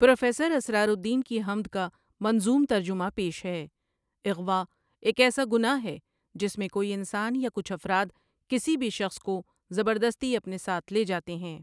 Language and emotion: Urdu, neutral